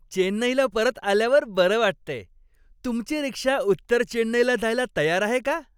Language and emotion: Marathi, happy